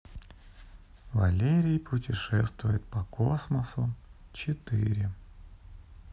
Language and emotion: Russian, neutral